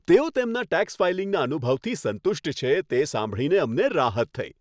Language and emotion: Gujarati, happy